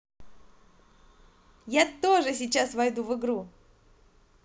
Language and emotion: Russian, positive